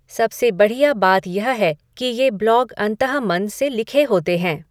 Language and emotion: Hindi, neutral